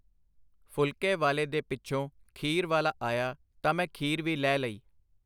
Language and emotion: Punjabi, neutral